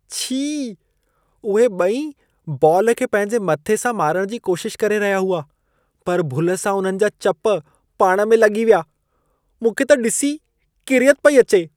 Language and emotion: Sindhi, disgusted